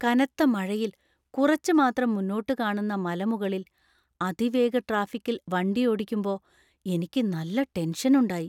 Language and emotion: Malayalam, fearful